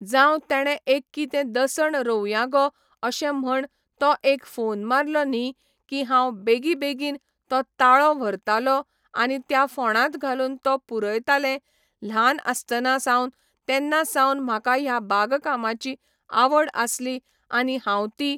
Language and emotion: Goan Konkani, neutral